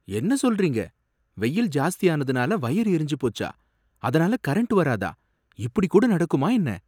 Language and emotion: Tamil, surprised